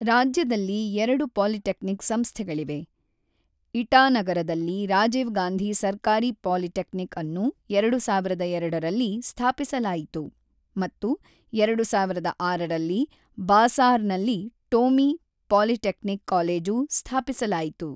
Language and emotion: Kannada, neutral